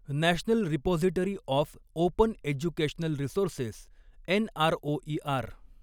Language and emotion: Marathi, neutral